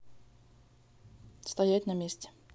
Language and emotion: Russian, neutral